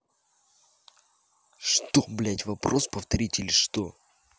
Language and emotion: Russian, angry